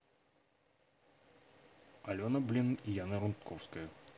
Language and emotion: Russian, neutral